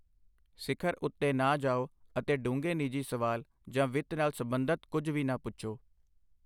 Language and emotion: Punjabi, neutral